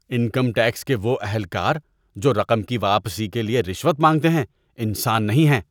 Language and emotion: Urdu, disgusted